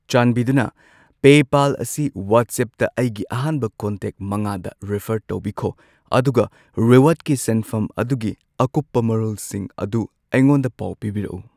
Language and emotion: Manipuri, neutral